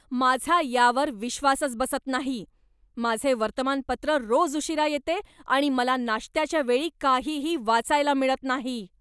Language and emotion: Marathi, angry